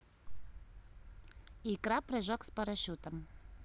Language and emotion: Russian, neutral